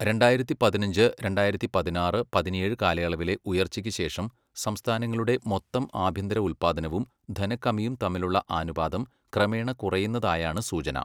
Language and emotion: Malayalam, neutral